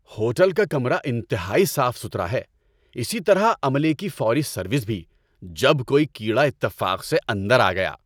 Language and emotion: Urdu, happy